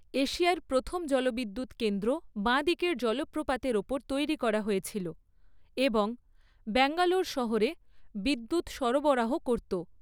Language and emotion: Bengali, neutral